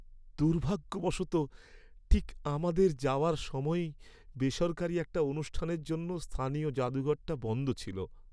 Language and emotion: Bengali, sad